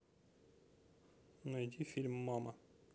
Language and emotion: Russian, neutral